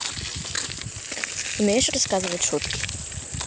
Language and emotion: Russian, neutral